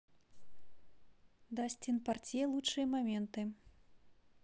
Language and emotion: Russian, neutral